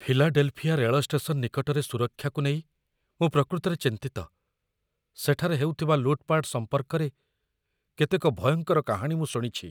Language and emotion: Odia, fearful